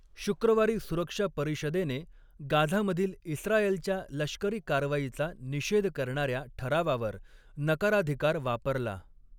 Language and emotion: Marathi, neutral